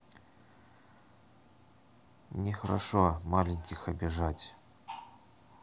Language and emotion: Russian, neutral